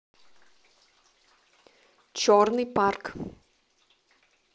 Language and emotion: Russian, neutral